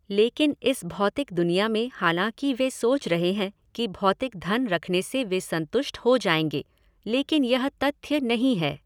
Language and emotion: Hindi, neutral